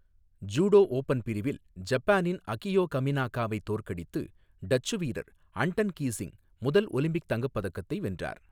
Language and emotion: Tamil, neutral